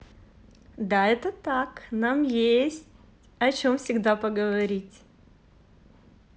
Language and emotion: Russian, positive